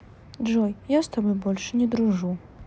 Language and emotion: Russian, sad